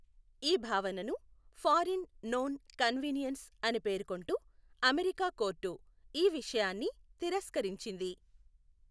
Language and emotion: Telugu, neutral